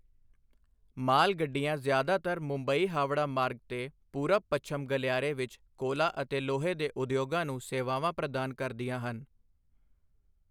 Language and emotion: Punjabi, neutral